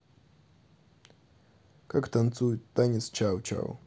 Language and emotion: Russian, neutral